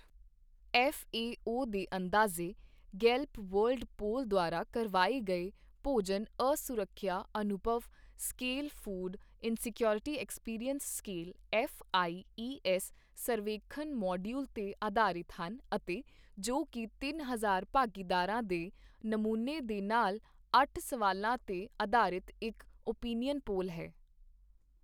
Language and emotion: Punjabi, neutral